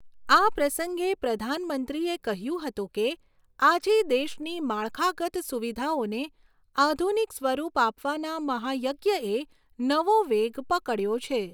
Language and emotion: Gujarati, neutral